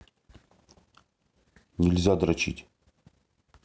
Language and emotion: Russian, neutral